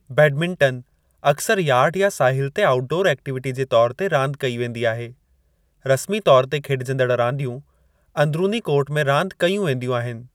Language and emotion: Sindhi, neutral